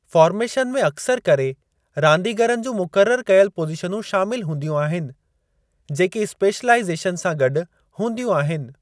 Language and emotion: Sindhi, neutral